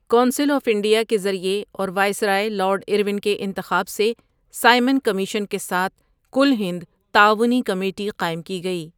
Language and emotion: Urdu, neutral